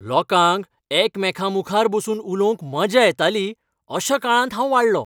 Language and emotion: Goan Konkani, happy